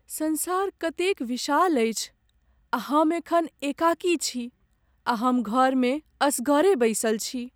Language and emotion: Maithili, sad